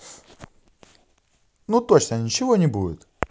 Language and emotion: Russian, positive